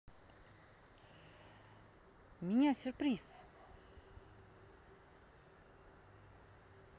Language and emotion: Russian, positive